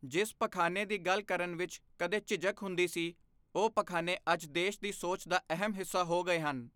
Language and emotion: Punjabi, neutral